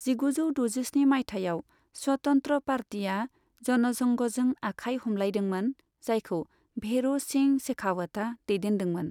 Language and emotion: Bodo, neutral